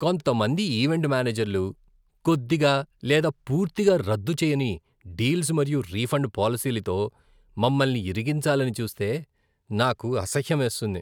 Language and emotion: Telugu, disgusted